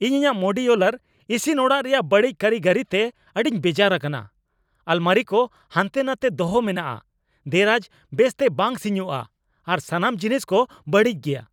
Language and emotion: Santali, angry